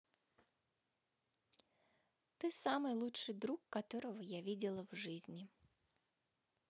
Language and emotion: Russian, neutral